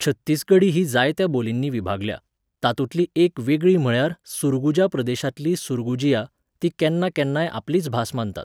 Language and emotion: Goan Konkani, neutral